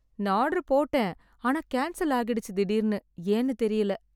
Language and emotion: Tamil, sad